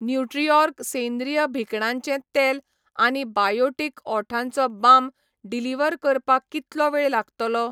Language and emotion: Goan Konkani, neutral